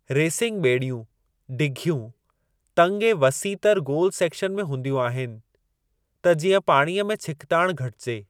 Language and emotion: Sindhi, neutral